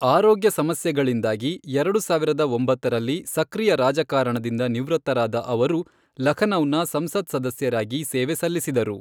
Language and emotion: Kannada, neutral